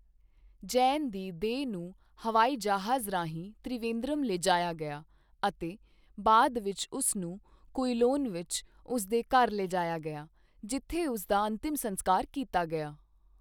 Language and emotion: Punjabi, neutral